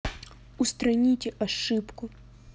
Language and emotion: Russian, neutral